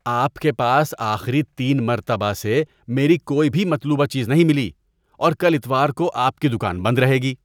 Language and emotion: Urdu, disgusted